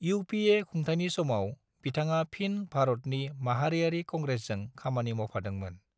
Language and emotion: Bodo, neutral